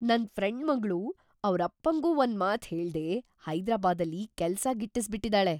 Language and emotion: Kannada, surprised